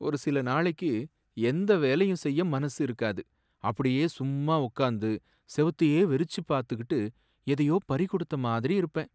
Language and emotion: Tamil, sad